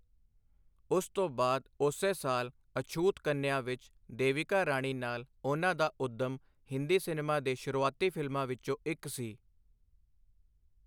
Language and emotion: Punjabi, neutral